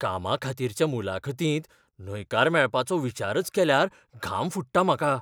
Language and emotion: Goan Konkani, fearful